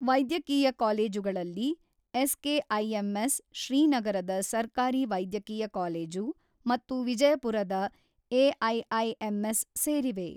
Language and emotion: Kannada, neutral